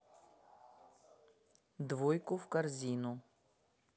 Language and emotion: Russian, neutral